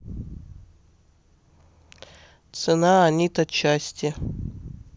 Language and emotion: Russian, neutral